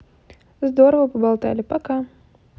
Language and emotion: Russian, positive